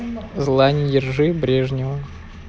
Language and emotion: Russian, neutral